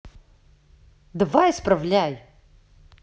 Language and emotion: Russian, angry